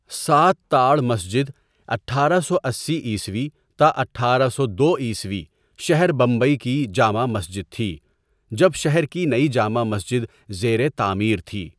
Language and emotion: Urdu, neutral